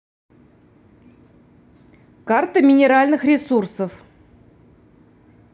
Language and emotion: Russian, neutral